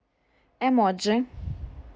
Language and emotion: Russian, neutral